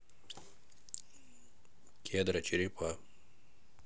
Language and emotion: Russian, neutral